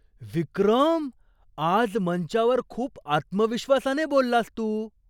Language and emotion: Marathi, surprised